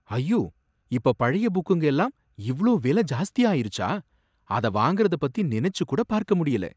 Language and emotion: Tamil, surprised